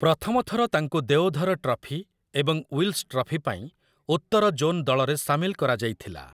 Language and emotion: Odia, neutral